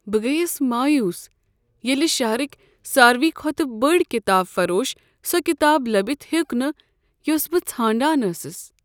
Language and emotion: Kashmiri, sad